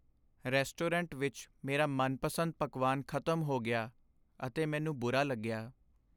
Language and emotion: Punjabi, sad